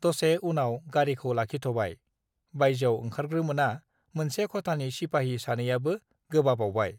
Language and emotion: Bodo, neutral